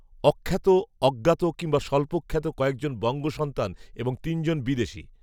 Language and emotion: Bengali, neutral